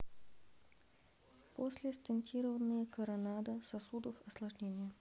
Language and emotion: Russian, neutral